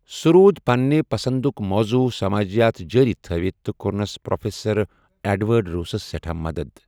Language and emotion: Kashmiri, neutral